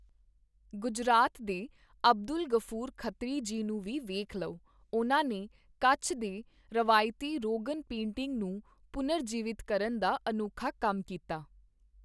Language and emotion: Punjabi, neutral